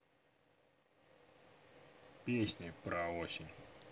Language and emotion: Russian, neutral